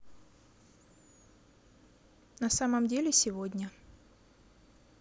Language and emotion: Russian, neutral